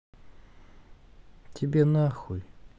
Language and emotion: Russian, neutral